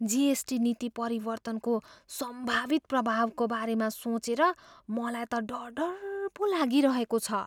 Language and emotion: Nepali, fearful